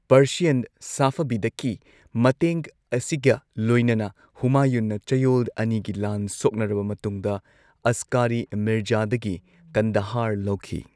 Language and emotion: Manipuri, neutral